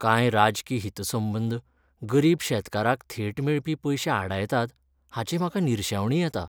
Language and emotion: Goan Konkani, sad